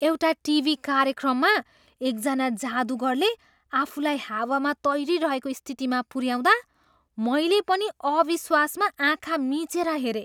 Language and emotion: Nepali, surprised